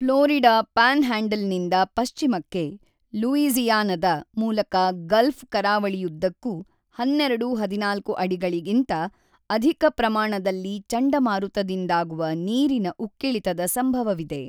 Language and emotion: Kannada, neutral